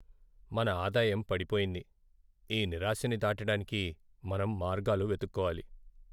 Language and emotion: Telugu, sad